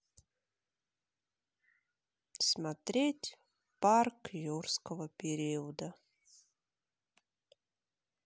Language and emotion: Russian, sad